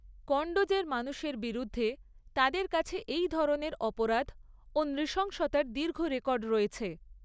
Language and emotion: Bengali, neutral